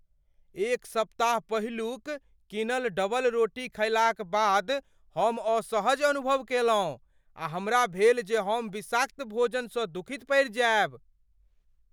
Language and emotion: Maithili, fearful